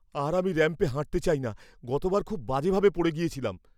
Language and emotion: Bengali, fearful